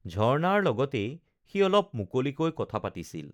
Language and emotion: Assamese, neutral